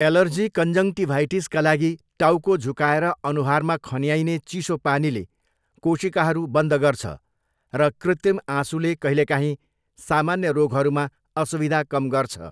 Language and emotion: Nepali, neutral